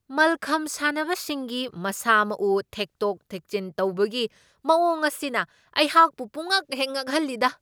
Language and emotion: Manipuri, surprised